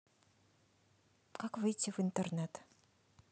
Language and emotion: Russian, neutral